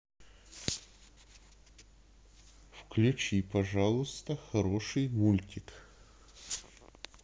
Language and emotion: Russian, neutral